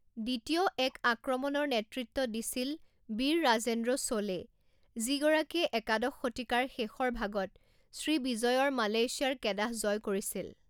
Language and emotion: Assamese, neutral